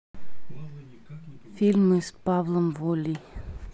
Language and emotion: Russian, neutral